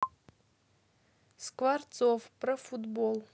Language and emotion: Russian, neutral